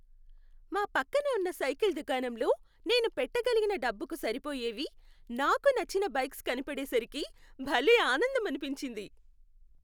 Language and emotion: Telugu, happy